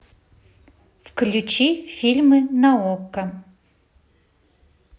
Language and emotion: Russian, neutral